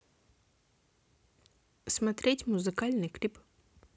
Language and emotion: Russian, positive